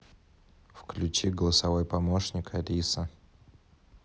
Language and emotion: Russian, neutral